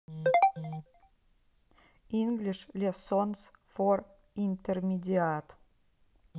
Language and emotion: Russian, neutral